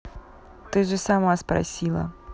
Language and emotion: Russian, neutral